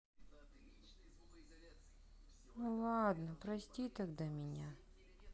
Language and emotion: Russian, sad